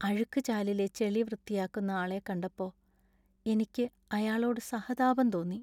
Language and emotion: Malayalam, sad